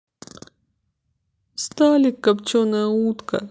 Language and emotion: Russian, sad